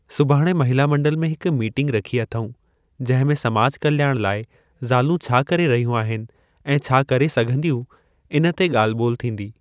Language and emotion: Sindhi, neutral